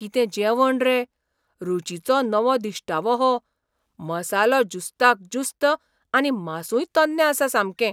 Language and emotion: Goan Konkani, surprised